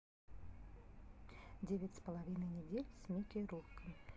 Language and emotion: Russian, neutral